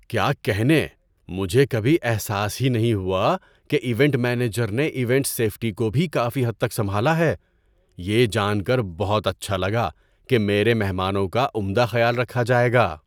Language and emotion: Urdu, surprised